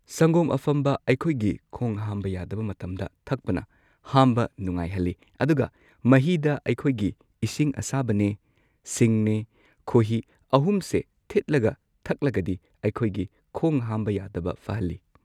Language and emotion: Manipuri, neutral